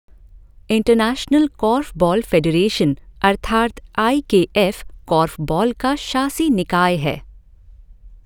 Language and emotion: Hindi, neutral